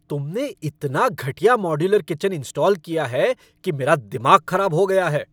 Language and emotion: Hindi, angry